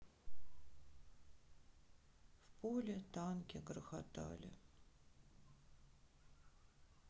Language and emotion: Russian, sad